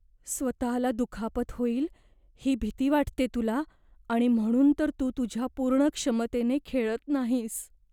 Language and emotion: Marathi, fearful